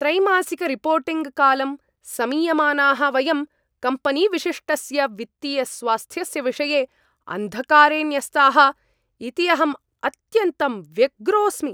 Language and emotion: Sanskrit, angry